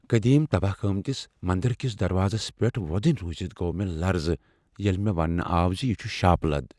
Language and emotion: Kashmiri, fearful